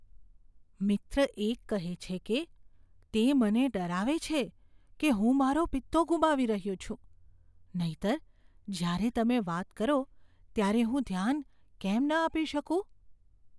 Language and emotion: Gujarati, fearful